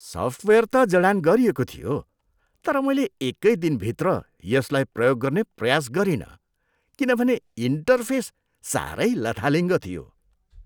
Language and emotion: Nepali, disgusted